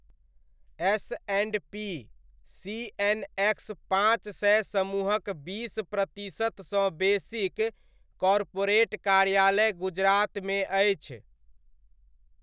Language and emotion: Maithili, neutral